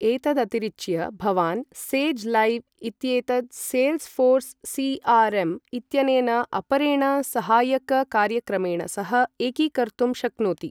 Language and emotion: Sanskrit, neutral